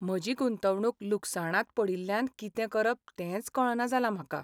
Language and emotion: Goan Konkani, sad